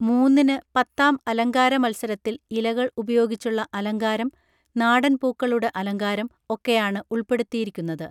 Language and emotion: Malayalam, neutral